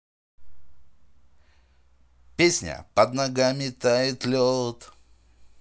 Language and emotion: Russian, positive